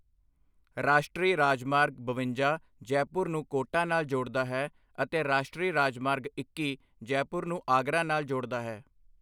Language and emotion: Punjabi, neutral